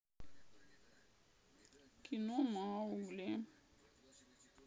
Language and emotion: Russian, sad